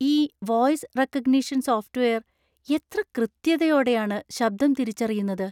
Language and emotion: Malayalam, surprised